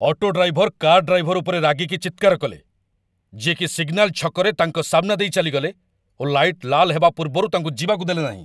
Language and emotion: Odia, angry